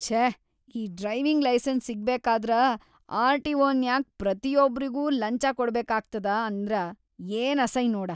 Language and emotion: Kannada, disgusted